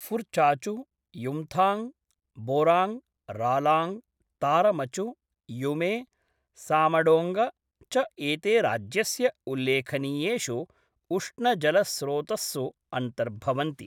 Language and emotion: Sanskrit, neutral